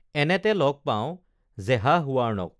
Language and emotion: Assamese, neutral